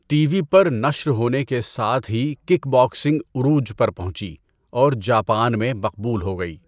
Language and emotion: Urdu, neutral